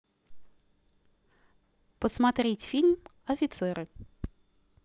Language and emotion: Russian, neutral